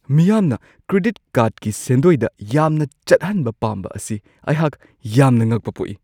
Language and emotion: Manipuri, surprised